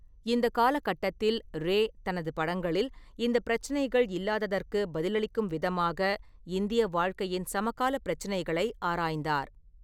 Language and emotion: Tamil, neutral